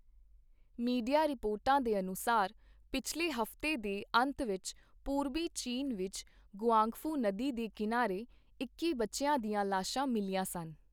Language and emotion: Punjabi, neutral